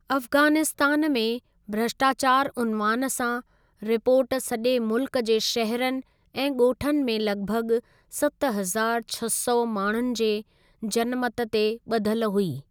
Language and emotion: Sindhi, neutral